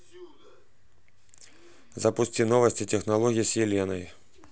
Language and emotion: Russian, neutral